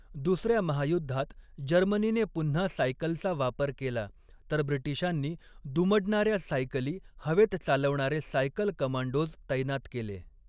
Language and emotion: Marathi, neutral